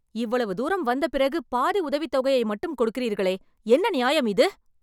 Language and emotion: Tamil, angry